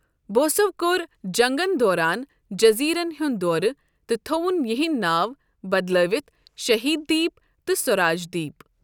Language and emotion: Kashmiri, neutral